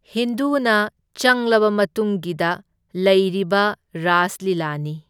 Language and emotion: Manipuri, neutral